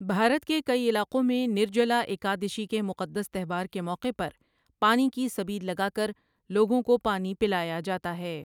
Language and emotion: Urdu, neutral